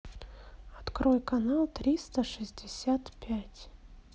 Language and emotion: Russian, neutral